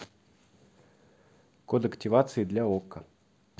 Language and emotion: Russian, neutral